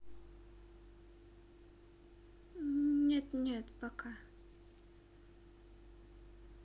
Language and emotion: Russian, neutral